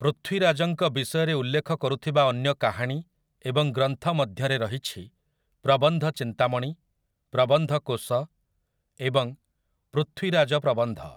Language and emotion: Odia, neutral